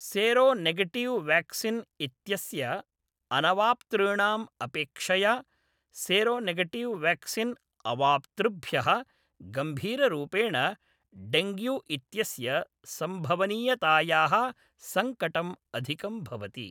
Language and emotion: Sanskrit, neutral